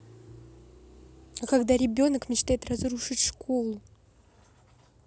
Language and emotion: Russian, neutral